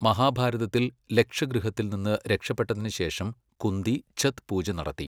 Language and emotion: Malayalam, neutral